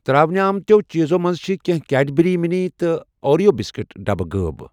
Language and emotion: Kashmiri, neutral